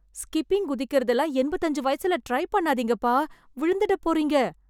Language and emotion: Tamil, fearful